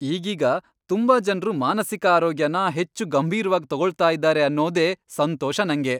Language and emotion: Kannada, happy